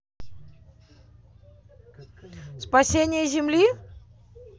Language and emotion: Russian, positive